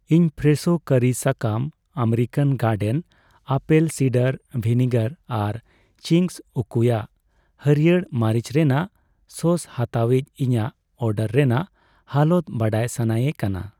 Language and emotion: Santali, neutral